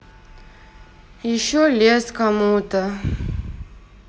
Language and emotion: Russian, sad